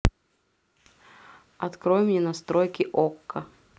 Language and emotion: Russian, neutral